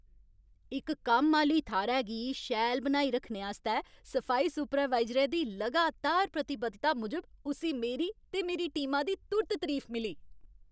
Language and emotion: Dogri, happy